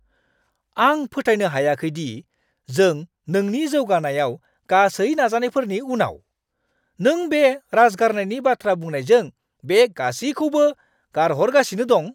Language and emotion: Bodo, angry